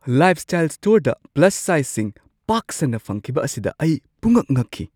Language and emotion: Manipuri, surprised